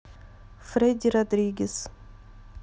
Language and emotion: Russian, neutral